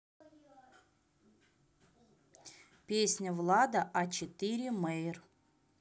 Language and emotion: Russian, neutral